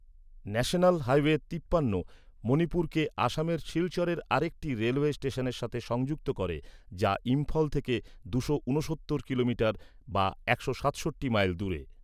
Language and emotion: Bengali, neutral